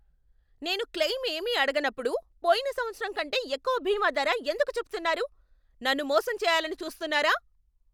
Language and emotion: Telugu, angry